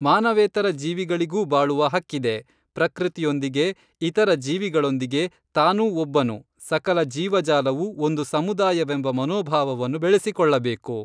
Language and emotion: Kannada, neutral